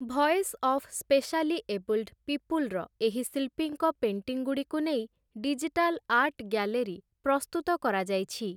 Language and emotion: Odia, neutral